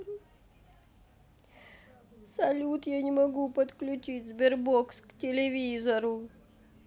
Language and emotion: Russian, sad